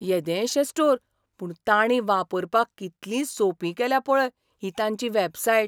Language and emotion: Goan Konkani, surprised